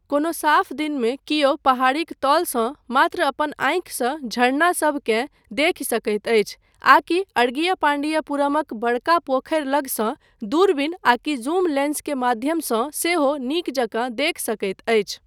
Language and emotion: Maithili, neutral